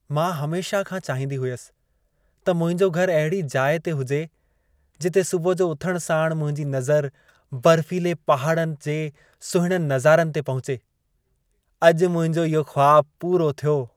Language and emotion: Sindhi, happy